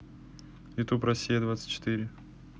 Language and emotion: Russian, neutral